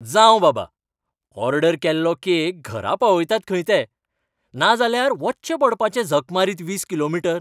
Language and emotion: Goan Konkani, happy